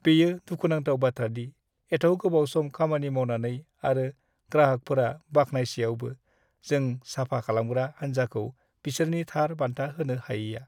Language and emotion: Bodo, sad